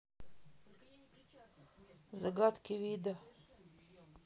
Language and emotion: Russian, neutral